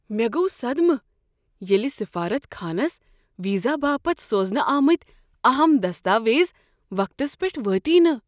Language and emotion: Kashmiri, surprised